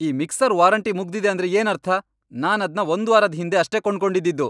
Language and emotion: Kannada, angry